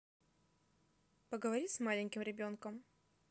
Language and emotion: Russian, neutral